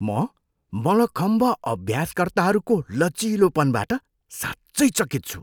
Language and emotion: Nepali, surprised